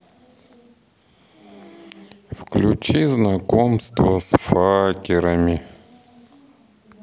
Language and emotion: Russian, sad